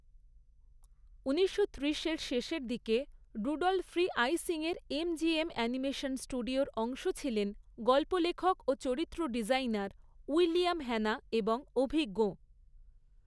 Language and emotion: Bengali, neutral